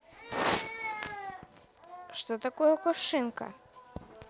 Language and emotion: Russian, neutral